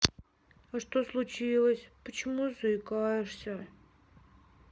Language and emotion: Russian, sad